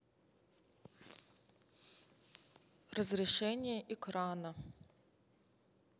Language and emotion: Russian, neutral